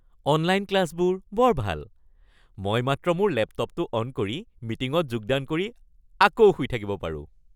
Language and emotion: Assamese, happy